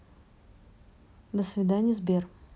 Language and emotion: Russian, neutral